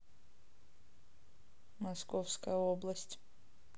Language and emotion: Russian, neutral